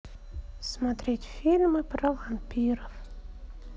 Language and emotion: Russian, sad